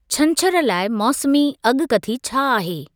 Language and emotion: Sindhi, neutral